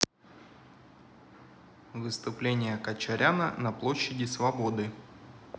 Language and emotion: Russian, neutral